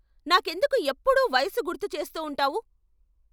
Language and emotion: Telugu, angry